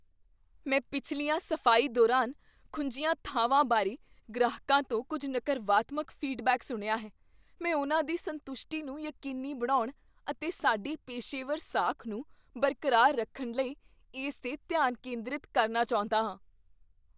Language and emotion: Punjabi, fearful